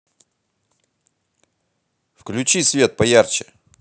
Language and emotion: Russian, positive